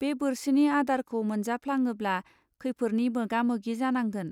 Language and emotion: Bodo, neutral